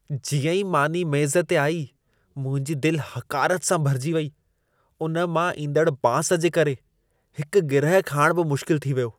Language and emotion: Sindhi, disgusted